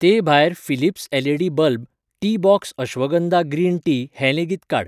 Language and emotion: Goan Konkani, neutral